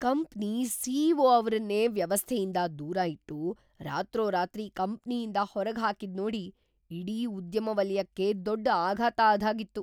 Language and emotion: Kannada, surprised